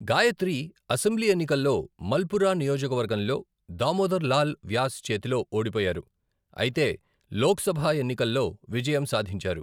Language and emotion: Telugu, neutral